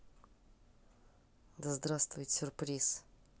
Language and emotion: Russian, neutral